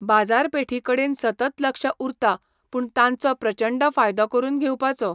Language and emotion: Goan Konkani, neutral